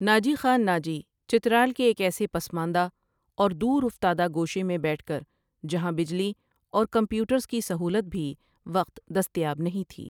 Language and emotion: Urdu, neutral